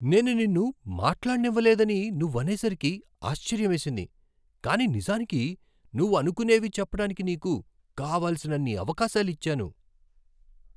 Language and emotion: Telugu, surprised